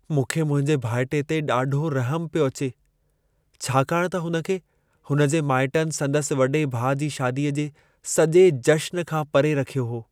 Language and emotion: Sindhi, sad